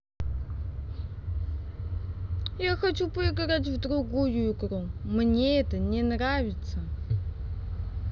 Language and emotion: Russian, sad